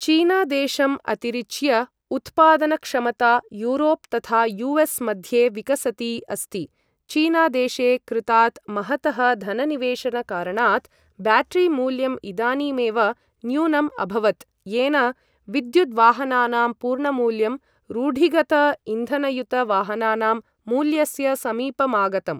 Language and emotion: Sanskrit, neutral